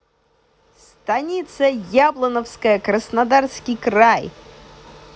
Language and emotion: Russian, positive